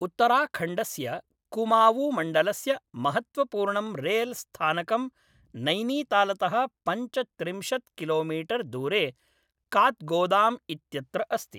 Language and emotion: Sanskrit, neutral